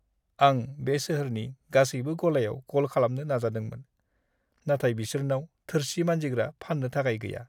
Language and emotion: Bodo, sad